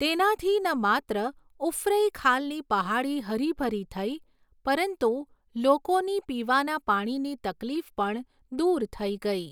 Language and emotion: Gujarati, neutral